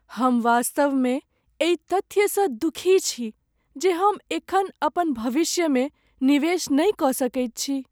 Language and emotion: Maithili, sad